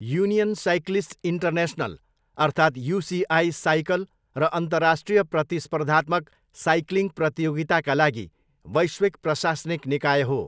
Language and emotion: Nepali, neutral